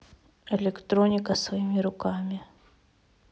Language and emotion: Russian, neutral